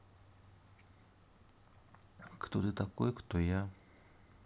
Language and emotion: Russian, neutral